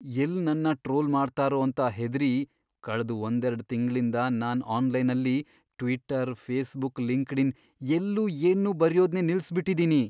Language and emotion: Kannada, fearful